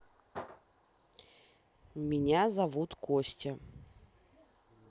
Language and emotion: Russian, neutral